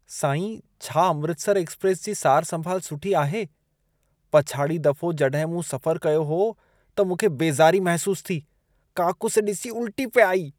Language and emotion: Sindhi, disgusted